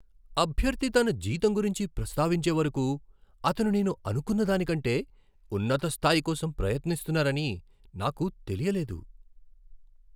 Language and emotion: Telugu, surprised